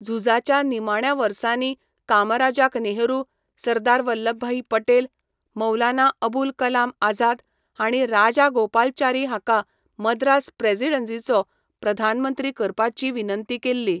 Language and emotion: Goan Konkani, neutral